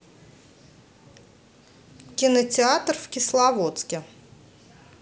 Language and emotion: Russian, neutral